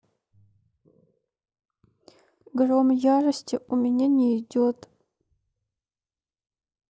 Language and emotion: Russian, sad